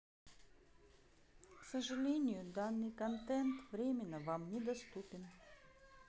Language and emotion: Russian, sad